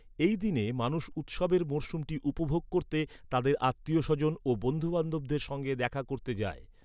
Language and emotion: Bengali, neutral